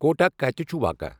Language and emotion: Kashmiri, neutral